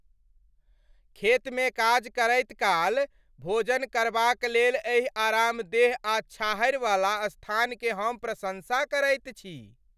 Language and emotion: Maithili, happy